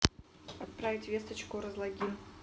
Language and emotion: Russian, neutral